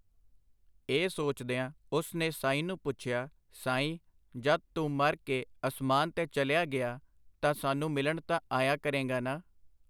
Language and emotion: Punjabi, neutral